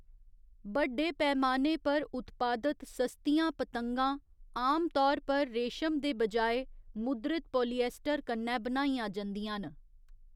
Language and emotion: Dogri, neutral